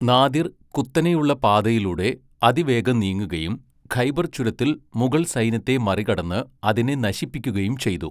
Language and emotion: Malayalam, neutral